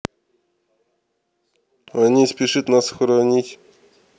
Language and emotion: Russian, neutral